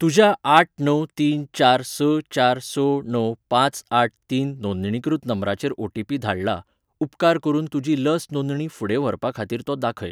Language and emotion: Goan Konkani, neutral